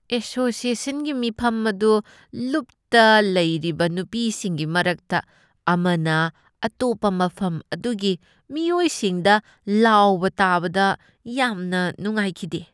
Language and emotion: Manipuri, disgusted